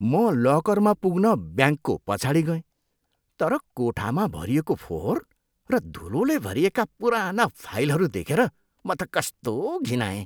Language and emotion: Nepali, disgusted